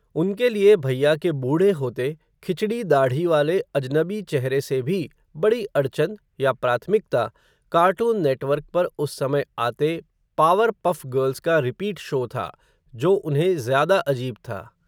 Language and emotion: Hindi, neutral